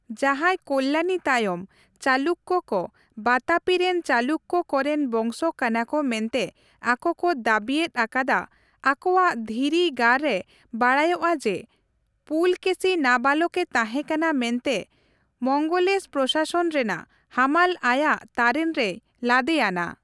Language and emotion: Santali, neutral